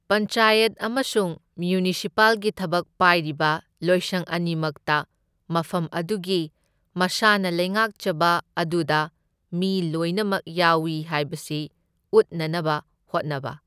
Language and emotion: Manipuri, neutral